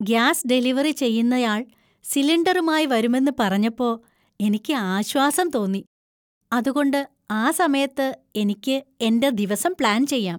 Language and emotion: Malayalam, happy